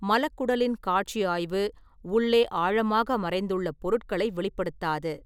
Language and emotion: Tamil, neutral